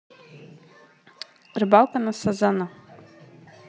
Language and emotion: Russian, neutral